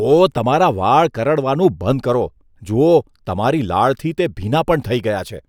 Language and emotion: Gujarati, disgusted